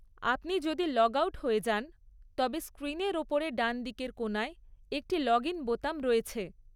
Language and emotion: Bengali, neutral